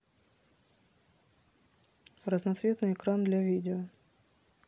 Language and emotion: Russian, neutral